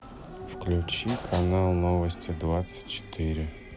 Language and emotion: Russian, sad